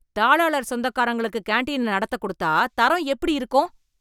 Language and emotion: Tamil, angry